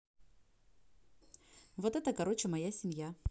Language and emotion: Russian, neutral